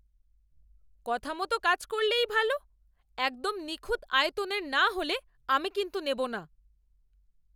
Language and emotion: Bengali, angry